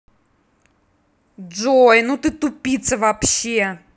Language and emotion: Russian, angry